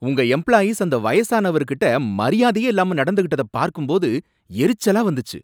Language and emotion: Tamil, angry